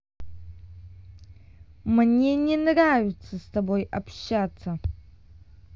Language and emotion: Russian, angry